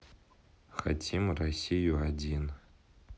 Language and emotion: Russian, neutral